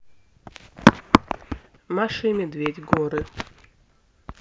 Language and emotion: Russian, neutral